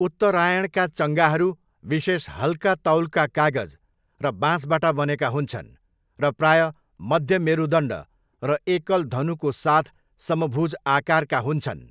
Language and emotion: Nepali, neutral